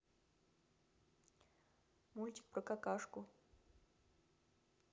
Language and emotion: Russian, neutral